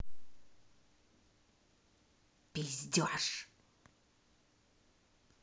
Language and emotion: Russian, angry